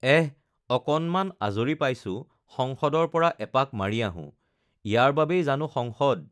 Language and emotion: Assamese, neutral